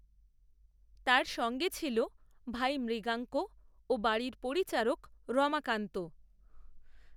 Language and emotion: Bengali, neutral